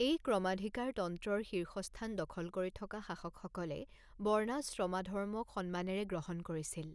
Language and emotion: Assamese, neutral